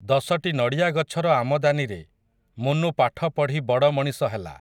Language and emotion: Odia, neutral